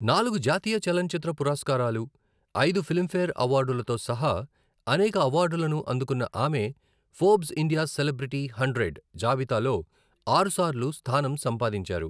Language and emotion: Telugu, neutral